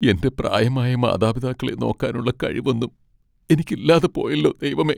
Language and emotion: Malayalam, sad